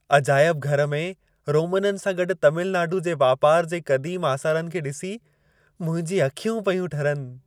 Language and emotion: Sindhi, happy